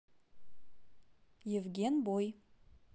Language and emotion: Russian, neutral